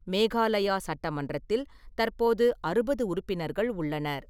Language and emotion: Tamil, neutral